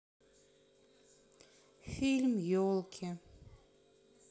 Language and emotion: Russian, sad